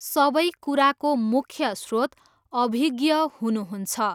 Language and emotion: Nepali, neutral